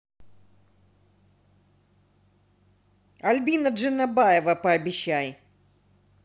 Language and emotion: Russian, neutral